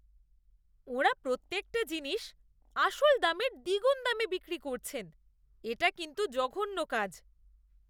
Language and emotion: Bengali, disgusted